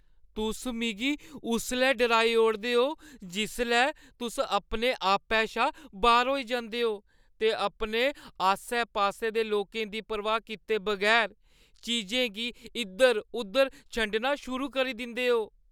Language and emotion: Dogri, fearful